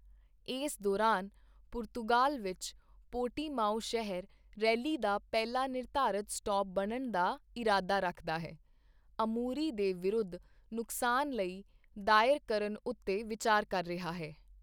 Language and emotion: Punjabi, neutral